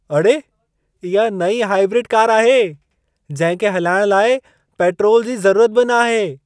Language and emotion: Sindhi, surprised